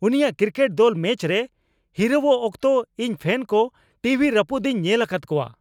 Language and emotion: Santali, angry